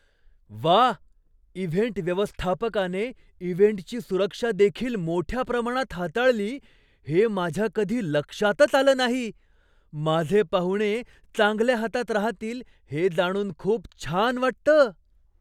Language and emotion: Marathi, surprised